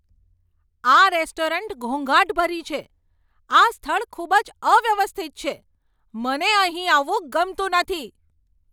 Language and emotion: Gujarati, angry